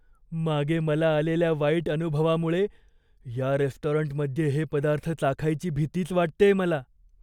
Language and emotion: Marathi, fearful